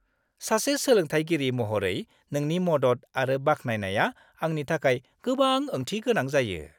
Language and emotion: Bodo, happy